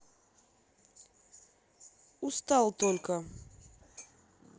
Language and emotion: Russian, neutral